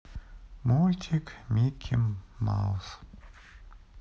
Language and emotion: Russian, sad